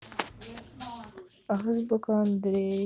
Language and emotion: Russian, sad